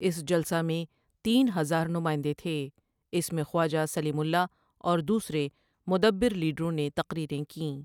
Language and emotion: Urdu, neutral